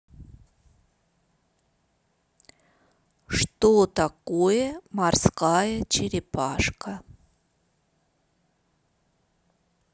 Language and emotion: Russian, neutral